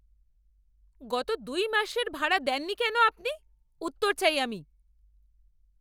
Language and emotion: Bengali, angry